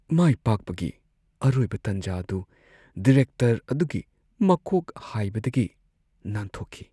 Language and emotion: Manipuri, sad